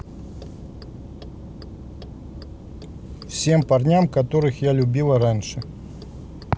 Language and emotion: Russian, neutral